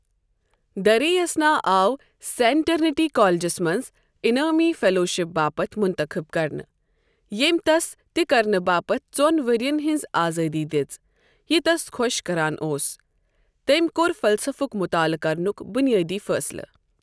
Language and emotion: Kashmiri, neutral